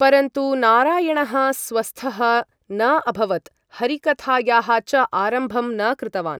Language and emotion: Sanskrit, neutral